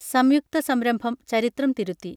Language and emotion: Malayalam, neutral